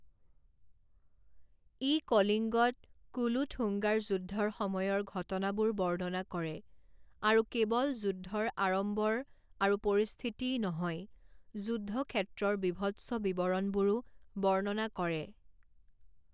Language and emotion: Assamese, neutral